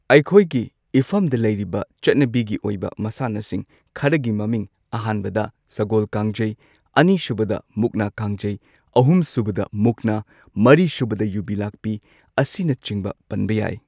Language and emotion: Manipuri, neutral